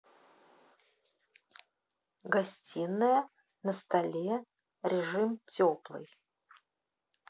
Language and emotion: Russian, neutral